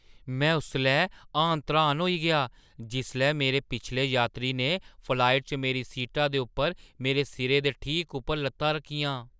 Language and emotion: Dogri, surprised